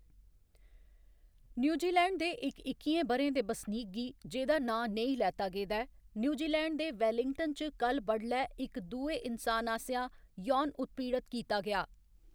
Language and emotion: Dogri, neutral